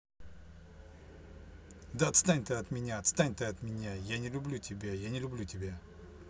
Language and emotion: Russian, angry